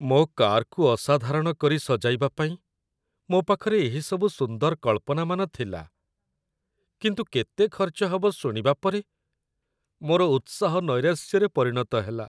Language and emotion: Odia, sad